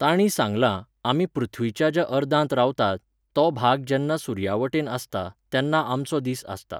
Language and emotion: Goan Konkani, neutral